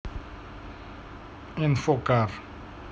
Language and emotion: Russian, neutral